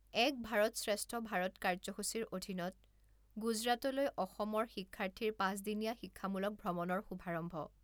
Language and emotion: Assamese, neutral